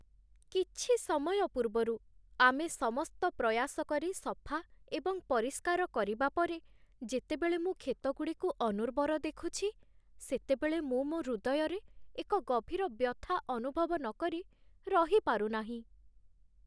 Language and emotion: Odia, sad